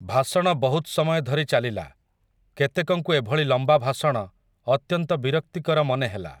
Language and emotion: Odia, neutral